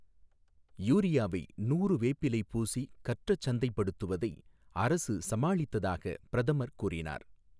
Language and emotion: Tamil, neutral